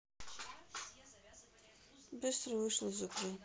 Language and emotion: Russian, sad